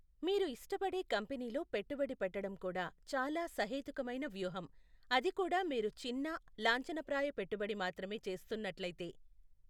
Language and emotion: Telugu, neutral